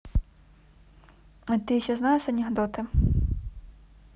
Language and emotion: Russian, neutral